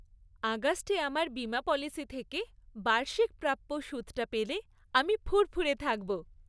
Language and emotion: Bengali, happy